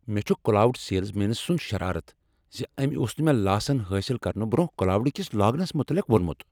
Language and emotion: Kashmiri, angry